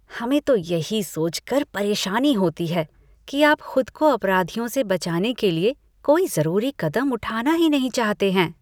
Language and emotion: Hindi, disgusted